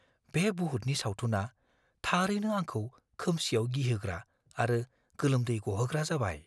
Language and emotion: Bodo, fearful